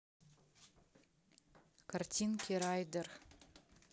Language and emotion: Russian, neutral